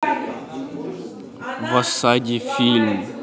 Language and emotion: Russian, neutral